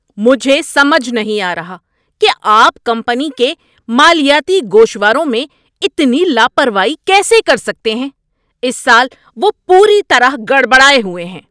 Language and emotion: Urdu, angry